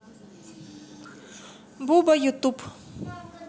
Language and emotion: Russian, neutral